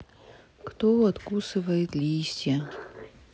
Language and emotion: Russian, sad